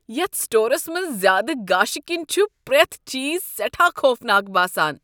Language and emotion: Kashmiri, disgusted